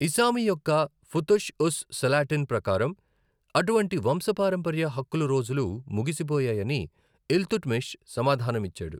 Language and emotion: Telugu, neutral